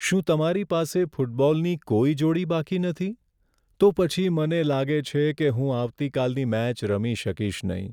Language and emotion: Gujarati, sad